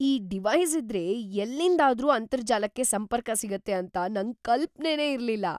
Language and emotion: Kannada, surprised